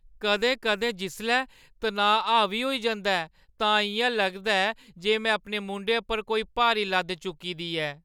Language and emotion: Dogri, sad